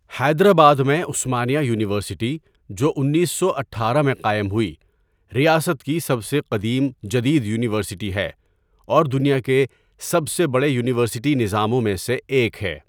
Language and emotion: Urdu, neutral